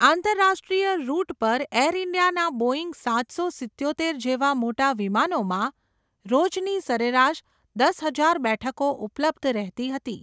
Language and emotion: Gujarati, neutral